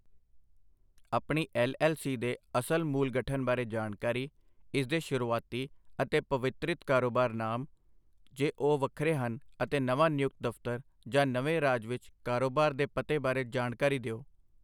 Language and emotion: Punjabi, neutral